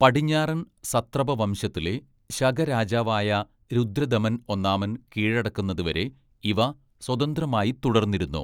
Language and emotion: Malayalam, neutral